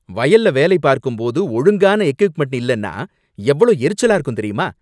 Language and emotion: Tamil, angry